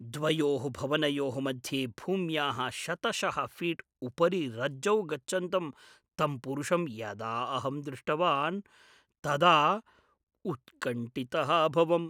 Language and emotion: Sanskrit, fearful